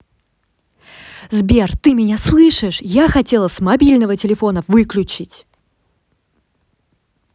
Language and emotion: Russian, angry